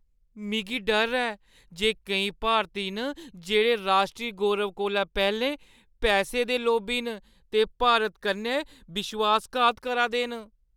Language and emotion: Dogri, fearful